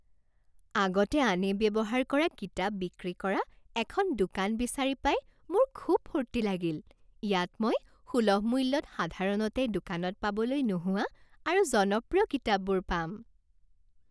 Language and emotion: Assamese, happy